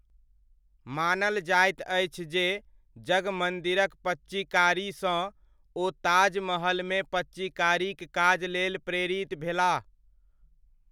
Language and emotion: Maithili, neutral